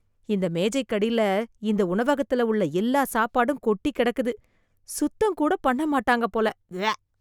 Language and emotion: Tamil, disgusted